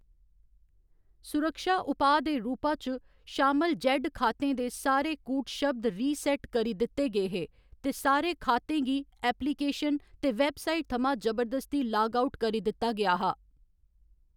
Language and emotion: Dogri, neutral